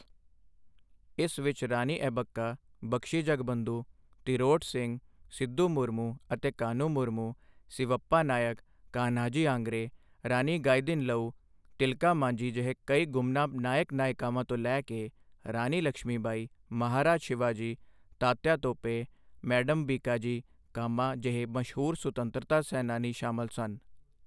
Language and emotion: Punjabi, neutral